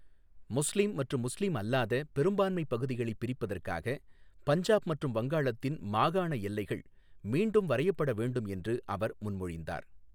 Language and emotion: Tamil, neutral